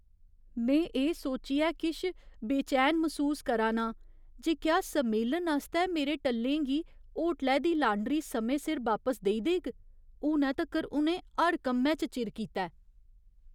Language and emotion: Dogri, fearful